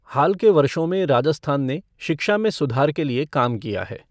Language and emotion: Hindi, neutral